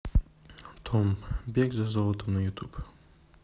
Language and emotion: Russian, neutral